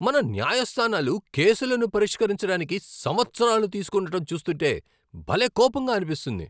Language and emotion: Telugu, angry